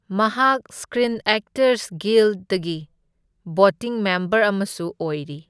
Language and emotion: Manipuri, neutral